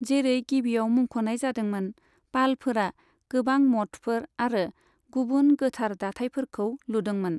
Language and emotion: Bodo, neutral